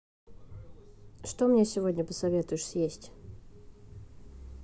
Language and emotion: Russian, neutral